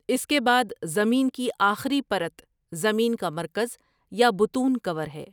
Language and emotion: Urdu, neutral